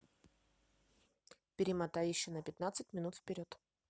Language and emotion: Russian, neutral